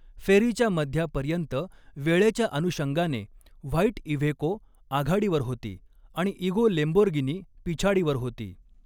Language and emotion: Marathi, neutral